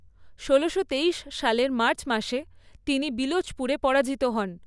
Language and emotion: Bengali, neutral